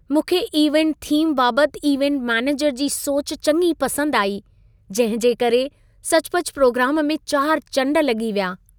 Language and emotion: Sindhi, happy